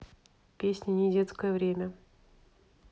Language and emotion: Russian, neutral